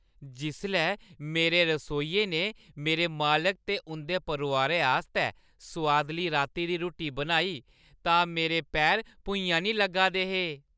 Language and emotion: Dogri, happy